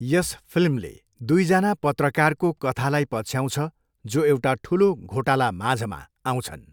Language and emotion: Nepali, neutral